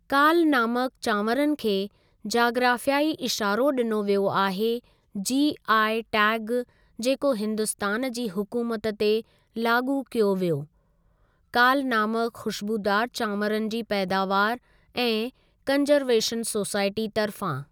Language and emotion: Sindhi, neutral